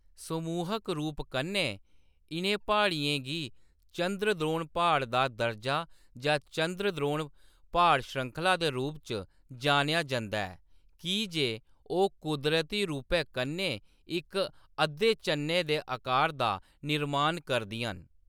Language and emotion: Dogri, neutral